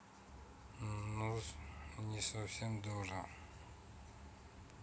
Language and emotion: Russian, neutral